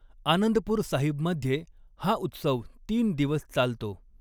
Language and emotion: Marathi, neutral